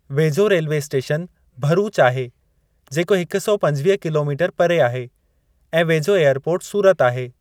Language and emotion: Sindhi, neutral